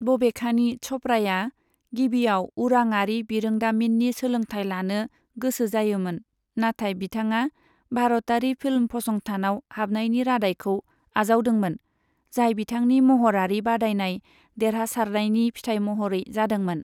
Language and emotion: Bodo, neutral